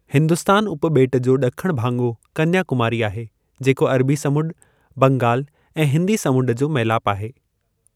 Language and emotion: Sindhi, neutral